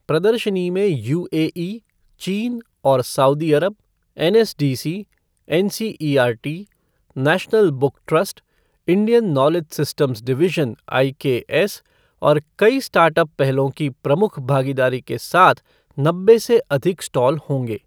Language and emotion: Hindi, neutral